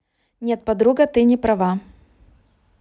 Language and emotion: Russian, neutral